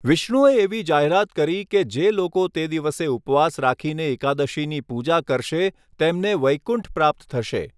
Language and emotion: Gujarati, neutral